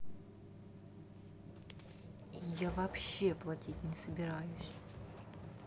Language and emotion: Russian, angry